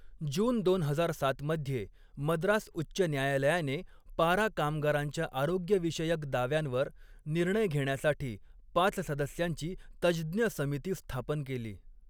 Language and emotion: Marathi, neutral